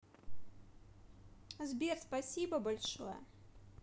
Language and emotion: Russian, positive